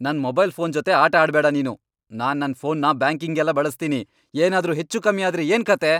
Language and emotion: Kannada, angry